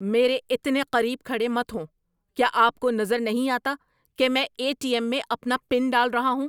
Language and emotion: Urdu, angry